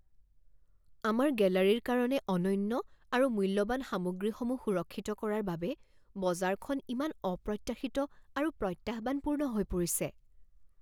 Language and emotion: Assamese, fearful